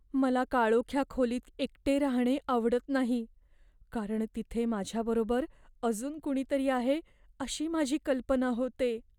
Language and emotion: Marathi, fearful